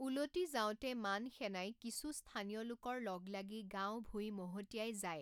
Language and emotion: Assamese, neutral